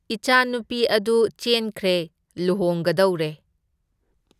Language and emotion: Manipuri, neutral